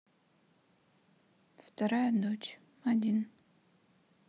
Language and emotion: Russian, sad